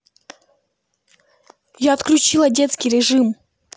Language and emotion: Russian, angry